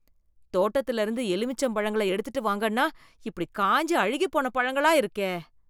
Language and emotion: Tamil, disgusted